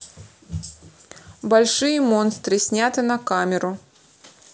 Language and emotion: Russian, neutral